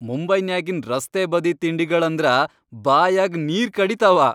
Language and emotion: Kannada, happy